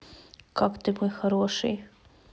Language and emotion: Russian, neutral